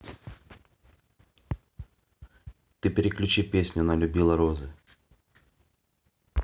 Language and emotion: Russian, neutral